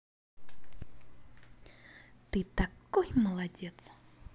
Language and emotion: Russian, positive